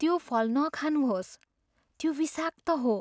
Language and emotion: Nepali, fearful